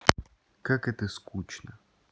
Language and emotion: Russian, neutral